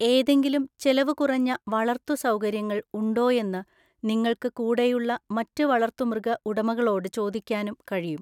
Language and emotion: Malayalam, neutral